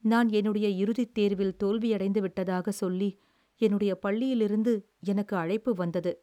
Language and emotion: Tamil, sad